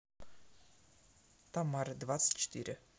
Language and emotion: Russian, neutral